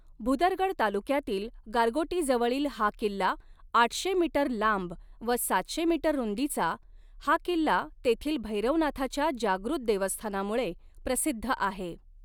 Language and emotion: Marathi, neutral